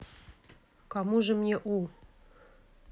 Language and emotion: Russian, neutral